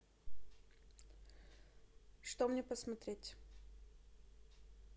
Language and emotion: Russian, neutral